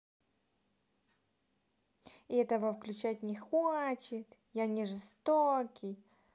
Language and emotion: Russian, angry